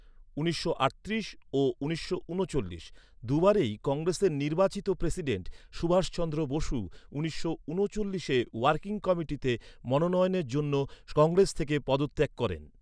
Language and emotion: Bengali, neutral